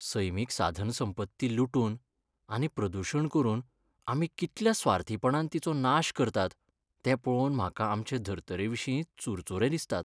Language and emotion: Goan Konkani, sad